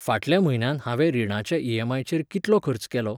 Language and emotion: Goan Konkani, neutral